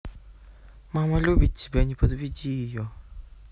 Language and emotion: Russian, neutral